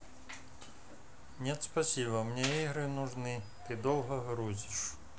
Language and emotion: Russian, neutral